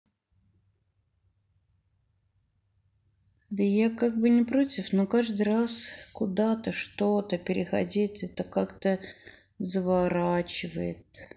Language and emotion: Russian, sad